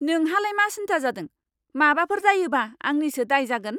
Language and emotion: Bodo, angry